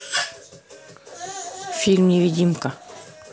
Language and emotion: Russian, neutral